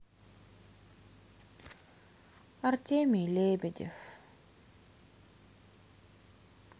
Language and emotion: Russian, sad